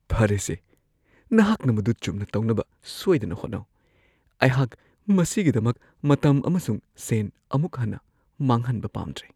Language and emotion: Manipuri, fearful